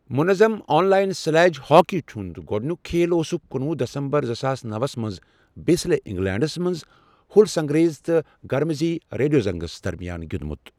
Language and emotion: Kashmiri, neutral